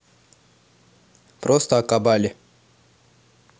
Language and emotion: Russian, neutral